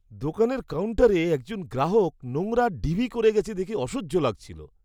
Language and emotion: Bengali, disgusted